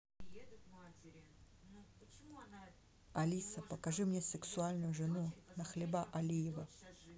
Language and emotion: Russian, neutral